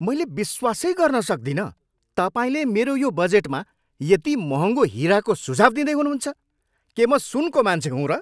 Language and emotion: Nepali, angry